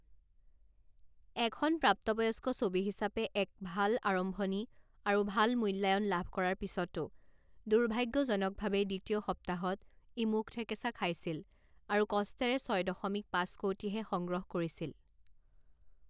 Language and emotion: Assamese, neutral